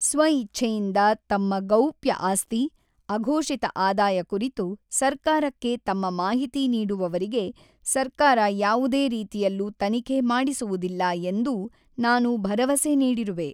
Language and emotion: Kannada, neutral